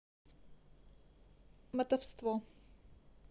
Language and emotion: Russian, neutral